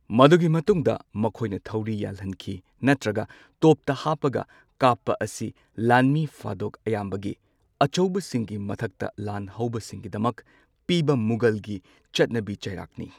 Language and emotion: Manipuri, neutral